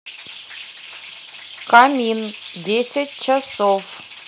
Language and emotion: Russian, neutral